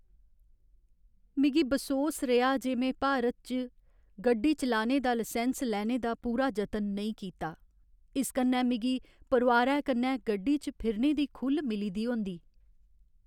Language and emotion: Dogri, sad